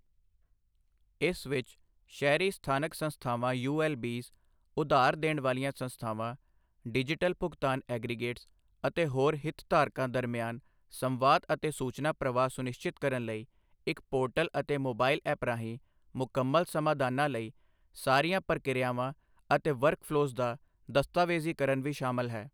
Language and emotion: Punjabi, neutral